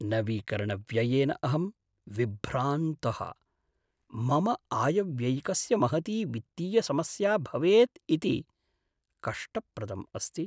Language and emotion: Sanskrit, sad